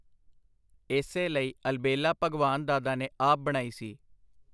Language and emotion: Punjabi, neutral